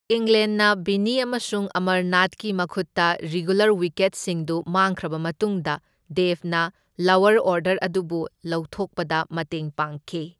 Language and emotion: Manipuri, neutral